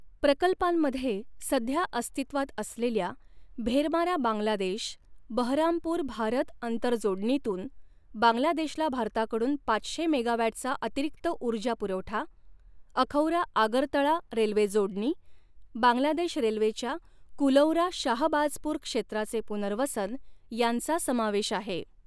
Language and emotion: Marathi, neutral